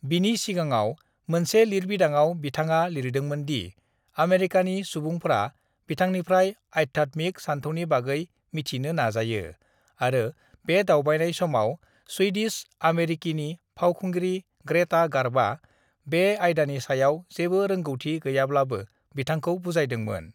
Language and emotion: Bodo, neutral